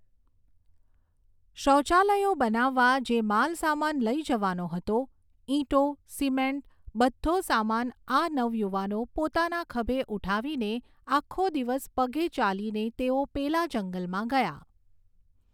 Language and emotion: Gujarati, neutral